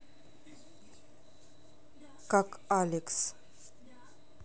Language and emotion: Russian, neutral